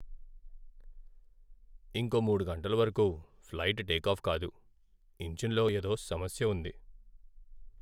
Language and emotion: Telugu, sad